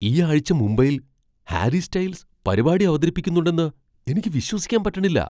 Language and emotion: Malayalam, surprised